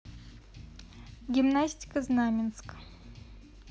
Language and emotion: Russian, neutral